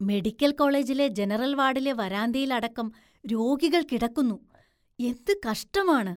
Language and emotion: Malayalam, disgusted